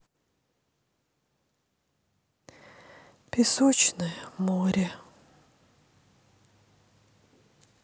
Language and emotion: Russian, sad